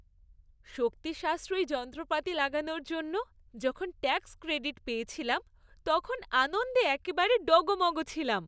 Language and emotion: Bengali, happy